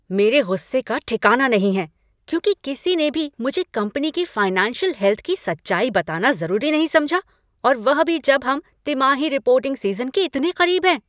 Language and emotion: Hindi, angry